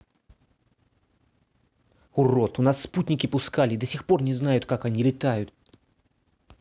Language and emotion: Russian, angry